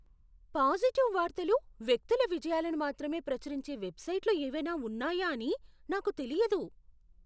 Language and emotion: Telugu, surprised